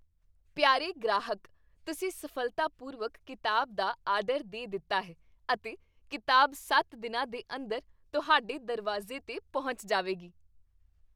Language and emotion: Punjabi, happy